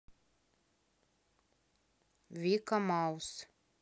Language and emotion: Russian, neutral